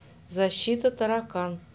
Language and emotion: Russian, neutral